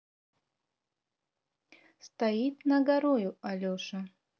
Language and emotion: Russian, neutral